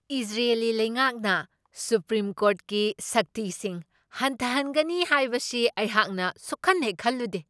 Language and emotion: Manipuri, surprised